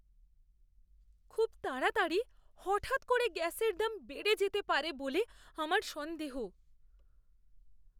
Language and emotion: Bengali, fearful